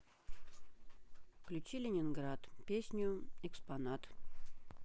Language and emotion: Russian, neutral